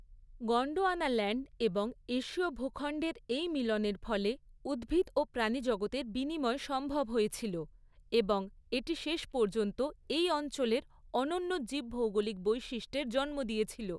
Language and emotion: Bengali, neutral